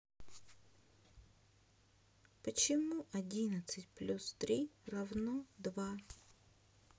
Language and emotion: Russian, sad